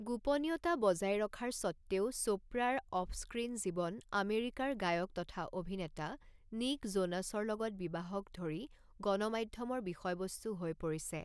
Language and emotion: Assamese, neutral